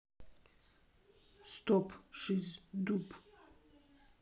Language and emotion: Russian, neutral